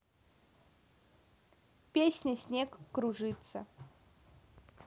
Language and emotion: Russian, neutral